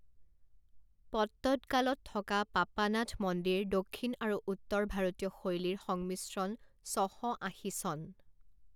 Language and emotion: Assamese, neutral